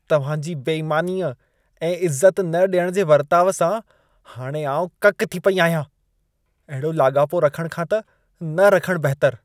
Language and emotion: Sindhi, disgusted